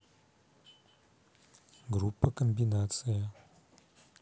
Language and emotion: Russian, neutral